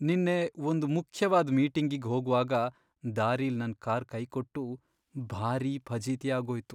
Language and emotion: Kannada, sad